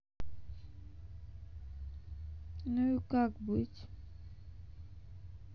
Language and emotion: Russian, sad